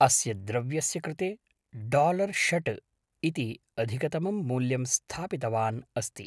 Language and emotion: Sanskrit, neutral